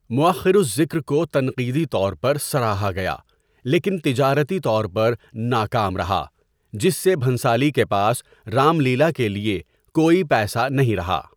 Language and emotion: Urdu, neutral